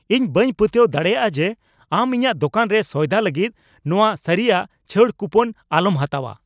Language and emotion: Santali, angry